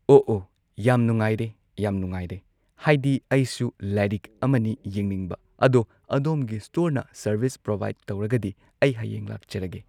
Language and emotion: Manipuri, neutral